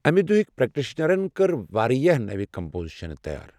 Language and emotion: Kashmiri, neutral